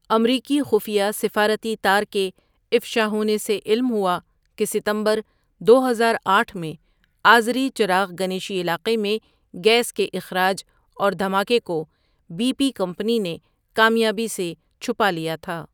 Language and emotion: Urdu, neutral